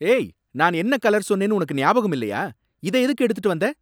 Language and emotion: Tamil, angry